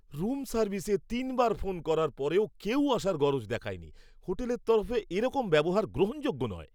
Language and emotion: Bengali, angry